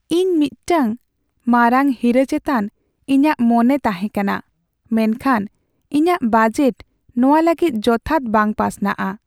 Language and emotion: Santali, sad